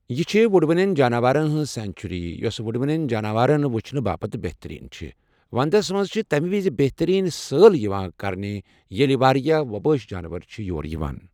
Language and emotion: Kashmiri, neutral